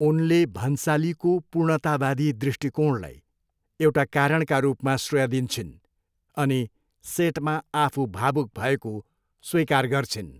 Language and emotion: Nepali, neutral